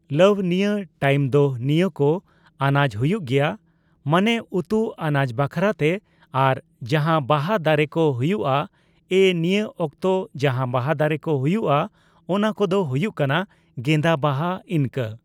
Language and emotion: Santali, neutral